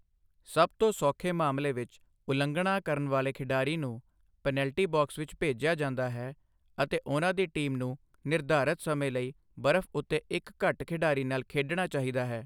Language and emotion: Punjabi, neutral